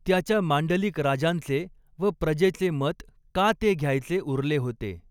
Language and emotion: Marathi, neutral